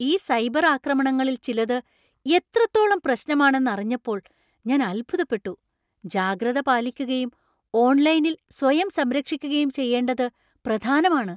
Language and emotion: Malayalam, surprised